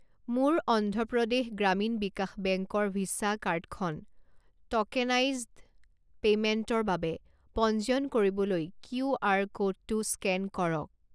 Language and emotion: Assamese, neutral